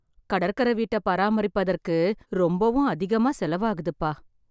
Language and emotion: Tamil, sad